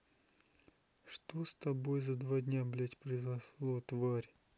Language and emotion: Russian, sad